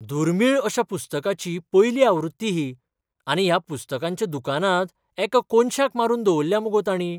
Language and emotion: Goan Konkani, surprised